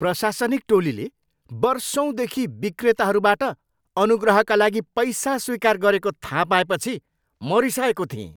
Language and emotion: Nepali, angry